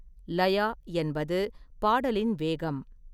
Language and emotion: Tamil, neutral